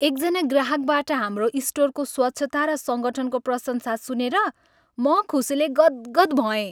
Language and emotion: Nepali, happy